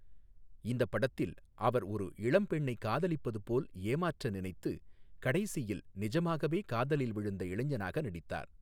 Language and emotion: Tamil, neutral